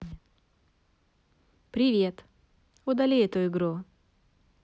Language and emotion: Russian, neutral